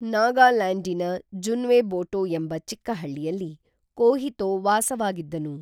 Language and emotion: Kannada, neutral